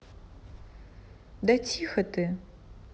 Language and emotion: Russian, neutral